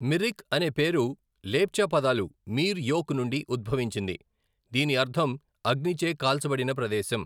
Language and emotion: Telugu, neutral